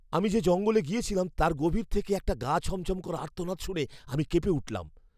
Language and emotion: Bengali, fearful